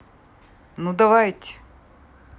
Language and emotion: Russian, neutral